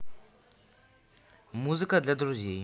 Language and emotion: Russian, neutral